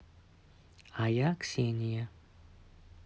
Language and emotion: Russian, neutral